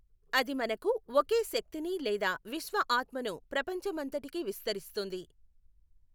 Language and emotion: Telugu, neutral